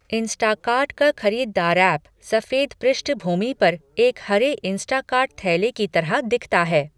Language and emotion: Hindi, neutral